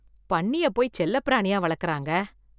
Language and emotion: Tamil, disgusted